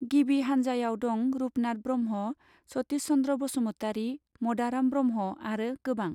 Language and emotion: Bodo, neutral